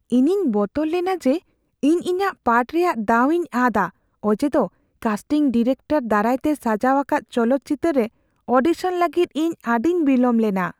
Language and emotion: Santali, fearful